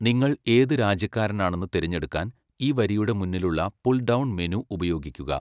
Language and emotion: Malayalam, neutral